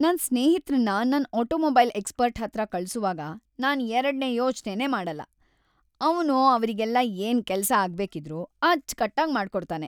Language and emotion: Kannada, happy